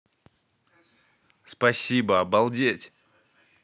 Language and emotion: Russian, positive